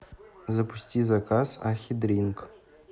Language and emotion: Russian, neutral